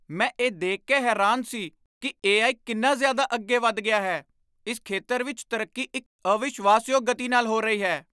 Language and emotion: Punjabi, surprised